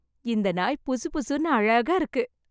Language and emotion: Tamil, happy